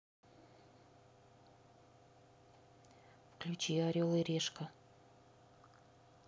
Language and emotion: Russian, neutral